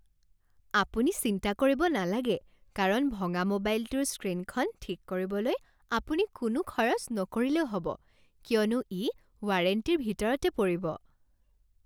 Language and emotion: Assamese, happy